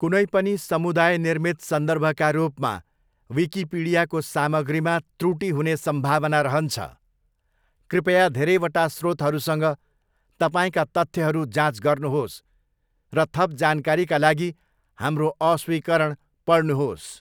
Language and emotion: Nepali, neutral